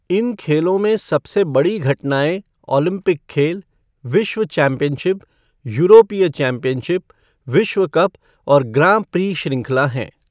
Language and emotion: Hindi, neutral